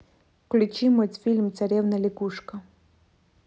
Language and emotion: Russian, neutral